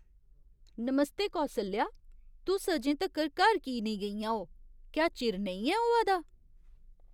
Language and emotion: Dogri, surprised